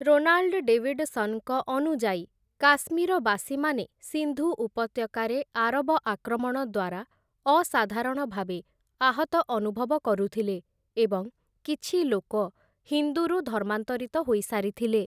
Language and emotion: Odia, neutral